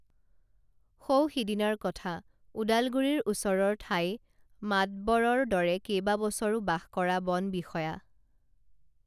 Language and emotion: Assamese, neutral